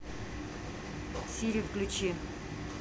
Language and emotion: Russian, angry